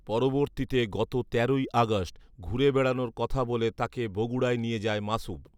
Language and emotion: Bengali, neutral